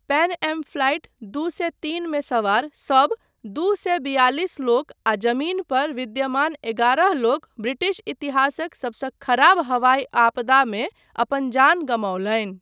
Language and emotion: Maithili, neutral